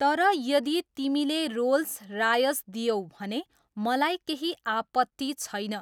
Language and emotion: Nepali, neutral